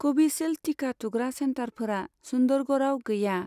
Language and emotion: Bodo, neutral